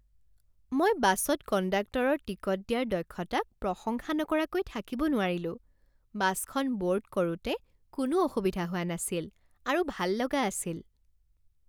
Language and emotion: Assamese, happy